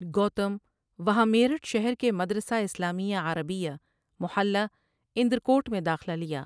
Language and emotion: Urdu, neutral